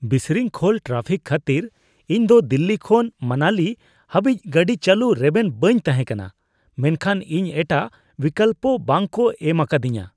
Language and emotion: Santali, disgusted